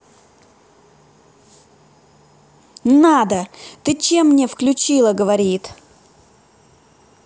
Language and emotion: Russian, angry